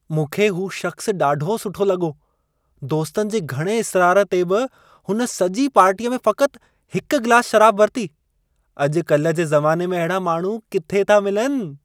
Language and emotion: Sindhi, happy